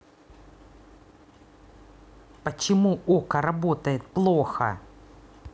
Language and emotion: Russian, angry